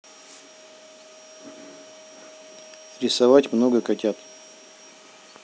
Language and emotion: Russian, neutral